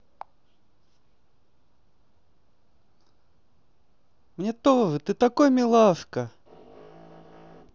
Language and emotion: Russian, positive